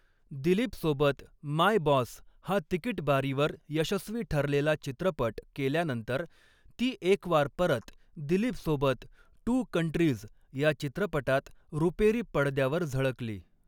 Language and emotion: Marathi, neutral